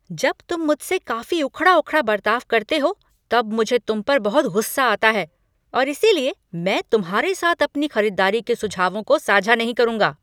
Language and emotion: Hindi, angry